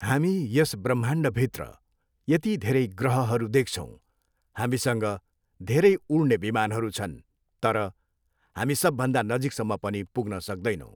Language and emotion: Nepali, neutral